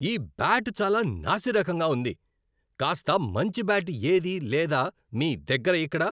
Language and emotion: Telugu, angry